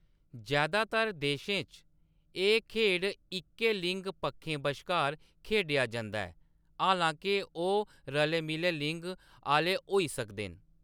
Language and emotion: Dogri, neutral